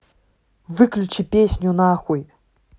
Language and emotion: Russian, angry